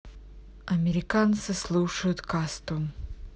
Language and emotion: Russian, neutral